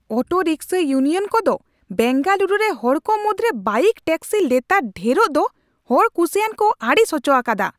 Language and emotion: Santali, angry